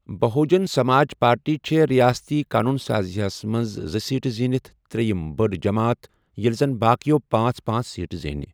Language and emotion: Kashmiri, neutral